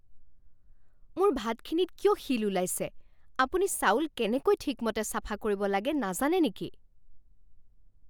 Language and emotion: Assamese, angry